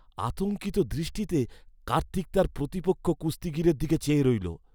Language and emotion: Bengali, fearful